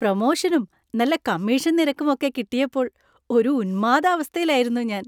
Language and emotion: Malayalam, happy